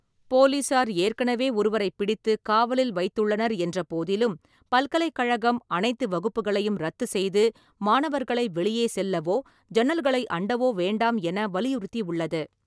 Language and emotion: Tamil, neutral